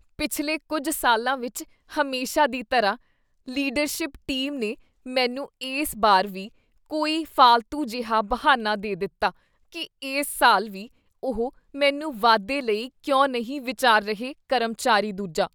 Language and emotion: Punjabi, disgusted